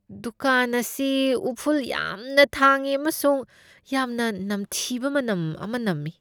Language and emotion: Manipuri, disgusted